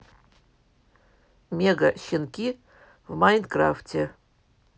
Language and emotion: Russian, neutral